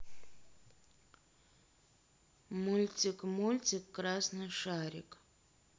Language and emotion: Russian, neutral